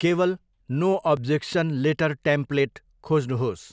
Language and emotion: Nepali, neutral